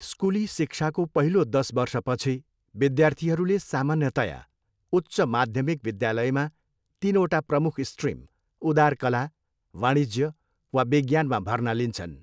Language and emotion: Nepali, neutral